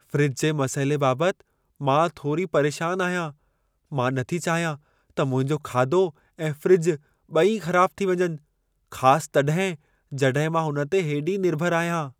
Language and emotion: Sindhi, fearful